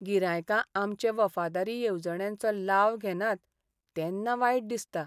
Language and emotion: Goan Konkani, sad